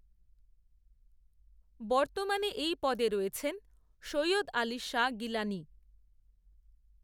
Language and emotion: Bengali, neutral